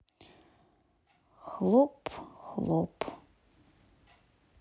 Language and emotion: Russian, sad